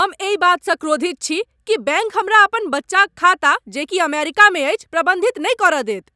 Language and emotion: Maithili, angry